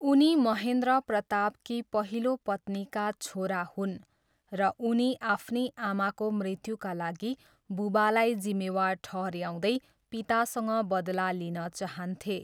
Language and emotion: Nepali, neutral